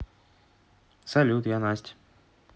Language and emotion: Russian, neutral